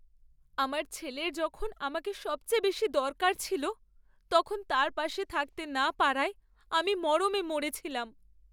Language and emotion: Bengali, sad